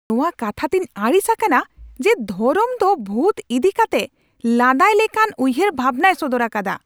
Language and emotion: Santali, angry